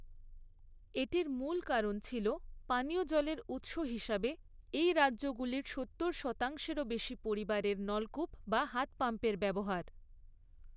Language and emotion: Bengali, neutral